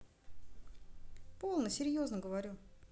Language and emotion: Russian, neutral